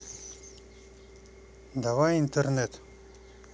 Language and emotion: Russian, neutral